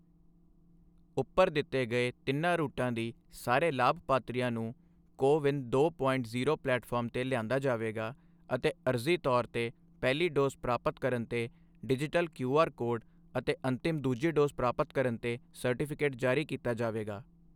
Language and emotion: Punjabi, neutral